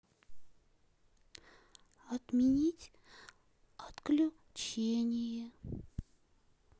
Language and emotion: Russian, sad